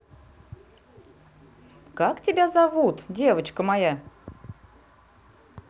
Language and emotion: Russian, positive